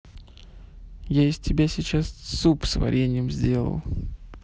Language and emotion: Russian, neutral